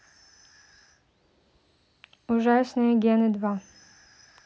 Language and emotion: Russian, neutral